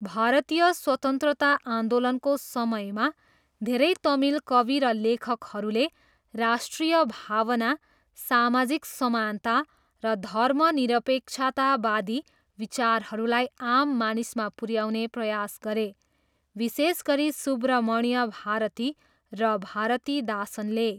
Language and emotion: Nepali, neutral